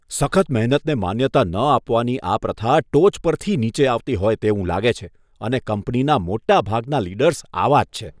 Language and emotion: Gujarati, disgusted